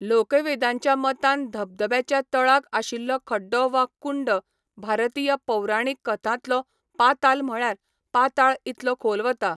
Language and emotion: Goan Konkani, neutral